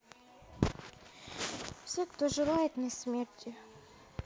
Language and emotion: Russian, sad